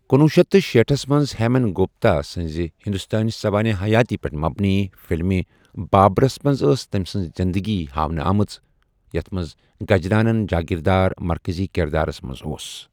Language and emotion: Kashmiri, neutral